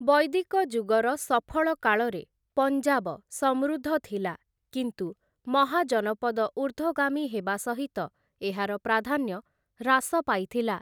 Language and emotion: Odia, neutral